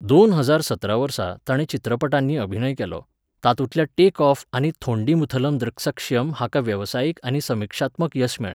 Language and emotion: Goan Konkani, neutral